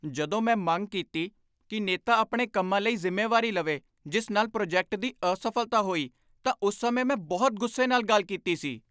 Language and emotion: Punjabi, angry